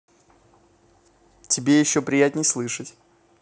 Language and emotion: Russian, positive